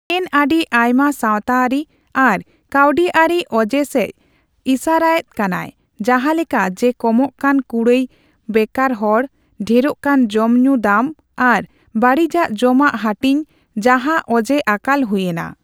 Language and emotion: Santali, neutral